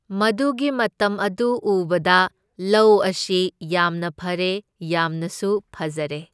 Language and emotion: Manipuri, neutral